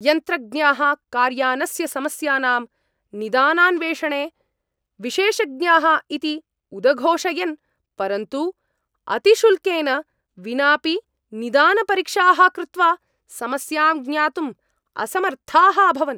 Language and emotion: Sanskrit, angry